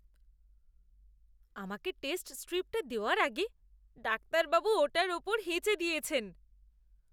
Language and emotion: Bengali, disgusted